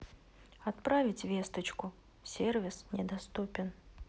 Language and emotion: Russian, sad